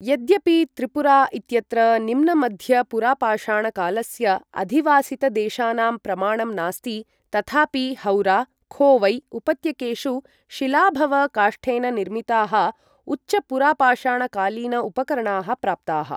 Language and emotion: Sanskrit, neutral